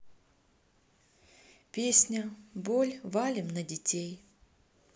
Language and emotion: Russian, neutral